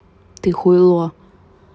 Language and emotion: Russian, angry